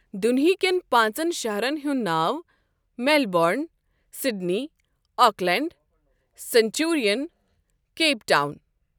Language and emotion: Kashmiri, neutral